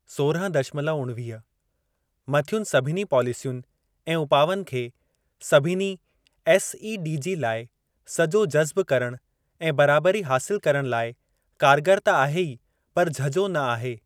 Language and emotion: Sindhi, neutral